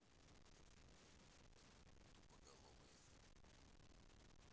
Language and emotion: Russian, neutral